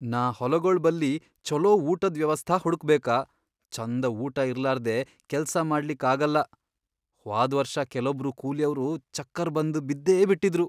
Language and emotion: Kannada, fearful